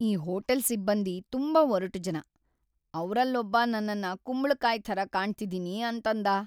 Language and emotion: Kannada, sad